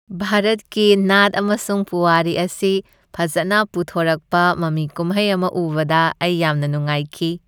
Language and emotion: Manipuri, happy